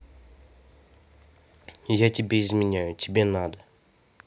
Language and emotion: Russian, neutral